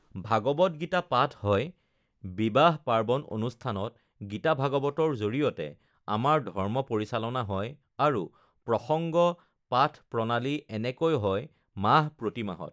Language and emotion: Assamese, neutral